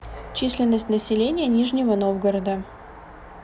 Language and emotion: Russian, neutral